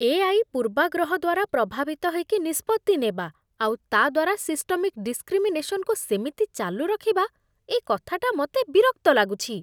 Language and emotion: Odia, disgusted